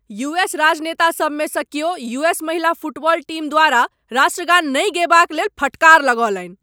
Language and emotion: Maithili, angry